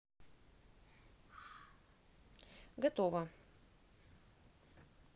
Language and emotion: Russian, neutral